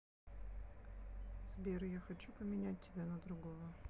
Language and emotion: Russian, neutral